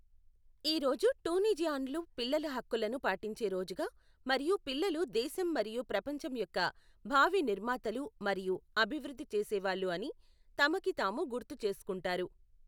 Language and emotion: Telugu, neutral